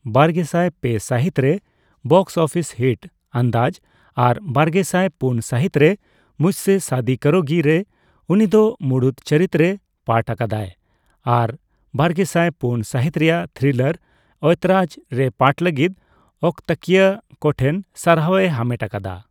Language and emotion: Santali, neutral